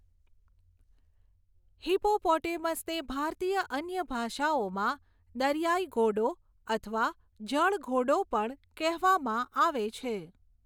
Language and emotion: Gujarati, neutral